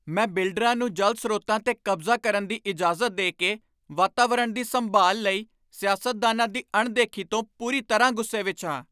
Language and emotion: Punjabi, angry